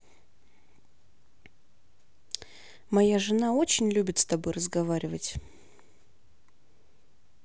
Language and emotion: Russian, neutral